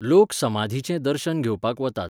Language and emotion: Goan Konkani, neutral